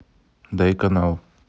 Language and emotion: Russian, neutral